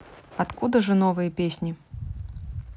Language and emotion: Russian, neutral